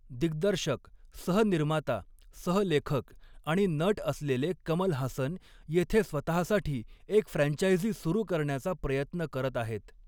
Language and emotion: Marathi, neutral